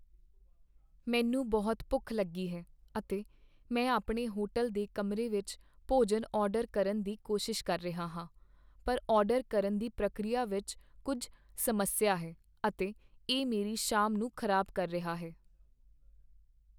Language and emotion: Punjabi, sad